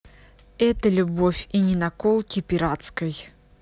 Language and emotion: Russian, angry